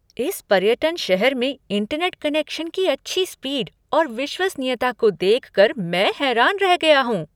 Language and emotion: Hindi, surprised